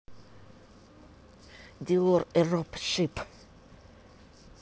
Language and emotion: Russian, angry